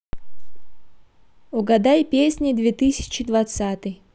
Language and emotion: Russian, positive